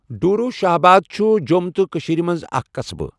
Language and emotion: Kashmiri, neutral